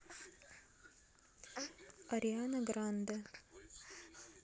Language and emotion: Russian, neutral